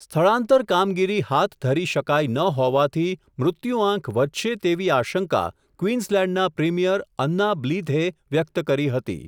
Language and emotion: Gujarati, neutral